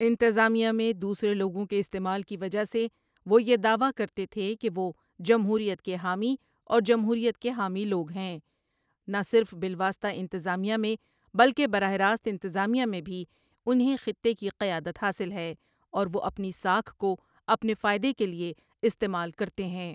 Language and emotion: Urdu, neutral